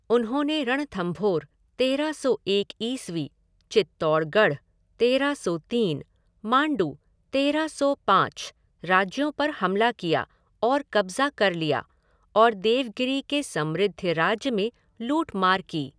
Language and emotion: Hindi, neutral